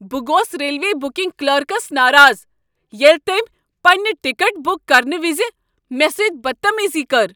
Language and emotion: Kashmiri, angry